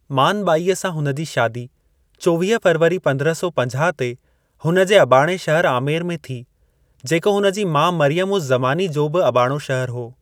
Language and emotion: Sindhi, neutral